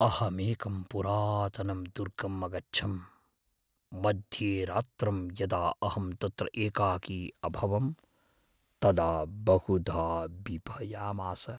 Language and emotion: Sanskrit, fearful